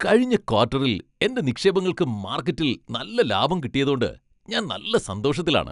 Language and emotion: Malayalam, happy